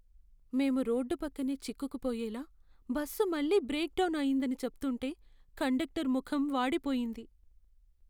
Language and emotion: Telugu, sad